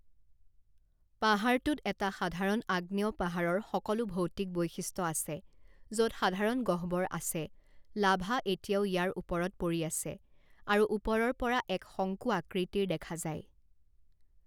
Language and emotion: Assamese, neutral